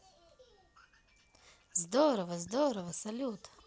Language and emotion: Russian, positive